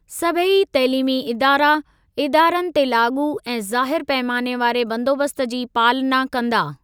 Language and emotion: Sindhi, neutral